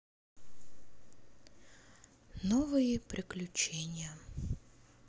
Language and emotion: Russian, sad